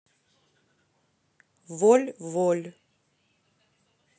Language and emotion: Russian, neutral